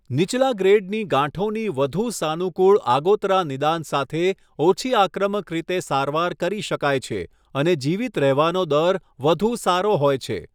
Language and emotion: Gujarati, neutral